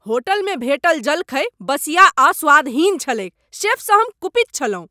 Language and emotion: Maithili, angry